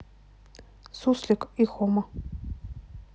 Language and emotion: Russian, neutral